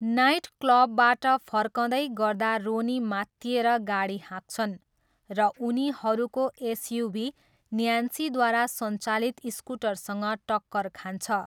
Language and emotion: Nepali, neutral